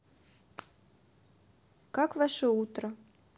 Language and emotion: Russian, neutral